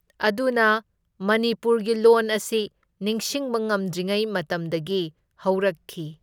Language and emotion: Manipuri, neutral